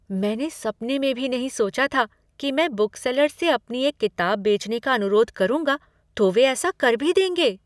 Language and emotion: Hindi, surprised